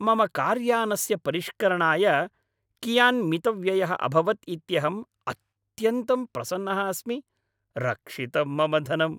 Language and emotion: Sanskrit, happy